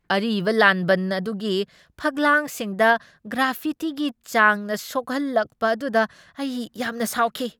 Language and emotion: Manipuri, angry